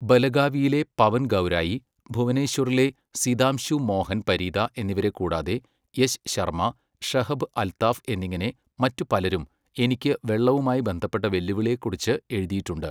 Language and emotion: Malayalam, neutral